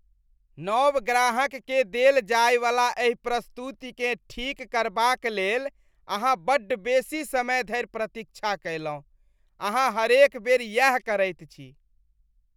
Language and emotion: Maithili, disgusted